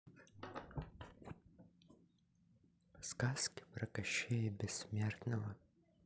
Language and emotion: Russian, neutral